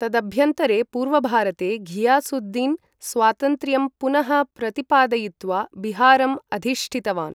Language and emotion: Sanskrit, neutral